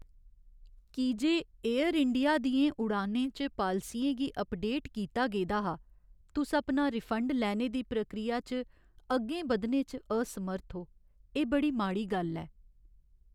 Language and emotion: Dogri, sad